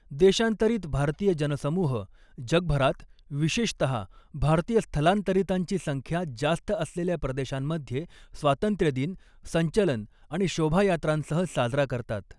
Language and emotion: Marathi, neutral